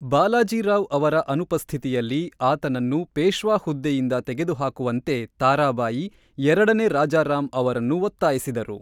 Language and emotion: Kannada, neutral